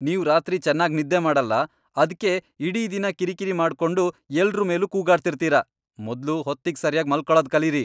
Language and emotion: Kannada, angry